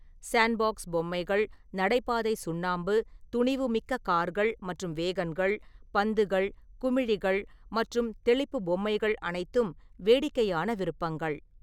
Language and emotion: Tamil, neutral